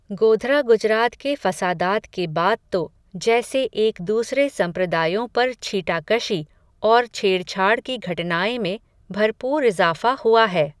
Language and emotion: Hindi, neutral